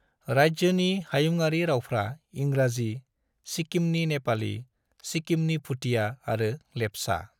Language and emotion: Bodo, neutral